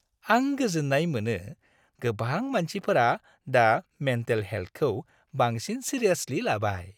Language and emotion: Bodo, happy